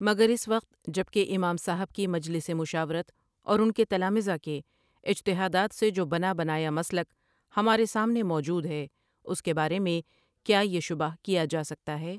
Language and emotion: Urdu, neutral